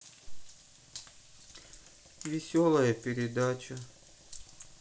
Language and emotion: Russian, sad